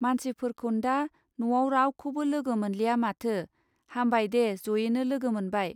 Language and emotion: Bodo, neutral